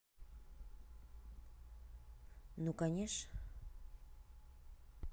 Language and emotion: Russian, neutral